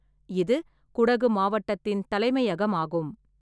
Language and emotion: Tamil, neutral